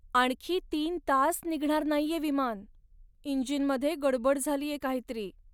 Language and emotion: Marathi, sad